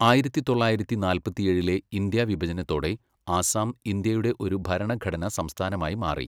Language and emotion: Malayalam, neutral